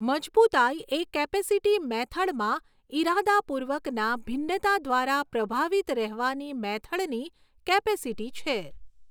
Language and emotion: Gujarati, neutral